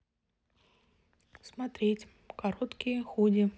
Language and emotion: Russian, neutral